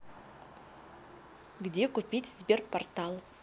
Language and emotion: Russian, neutral